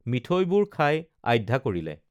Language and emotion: Assamese, neutral